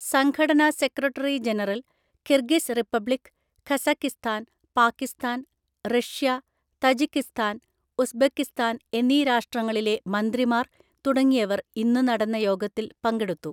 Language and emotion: Malayalam, neutral